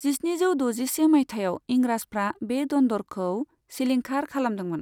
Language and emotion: Bodo, neutral